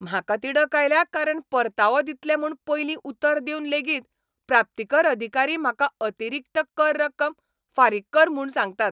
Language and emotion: Goan Konkani, angry